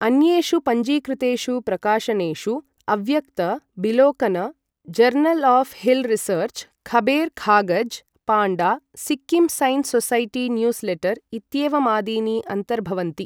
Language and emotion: Sanskrit, neutral